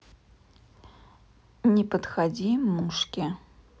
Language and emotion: Russian, neutral